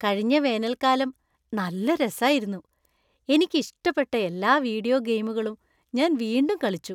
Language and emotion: Malayalam, happy